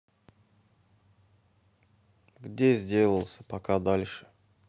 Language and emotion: Russian, neutral